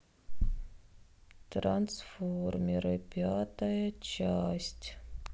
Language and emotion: Russian, sad